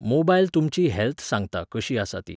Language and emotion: Goan Konkani, neutral